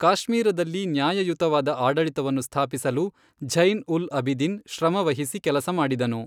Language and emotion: Kannada, neutral